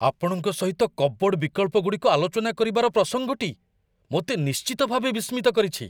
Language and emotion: Odia, surprised